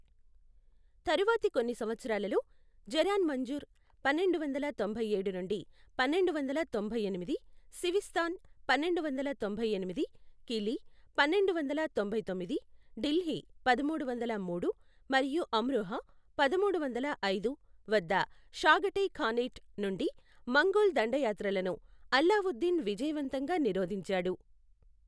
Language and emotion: Telugu, neutral